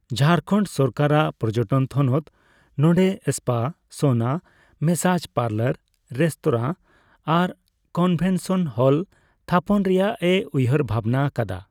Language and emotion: Santali, neutral